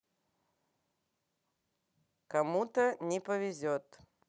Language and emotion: Russian, neutral